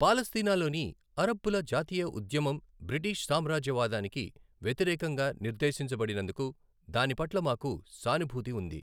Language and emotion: Telugu, neutral